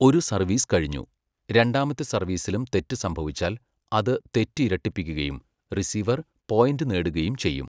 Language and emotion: Malayalam, neutral